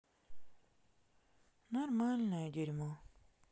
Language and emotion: Russian, sad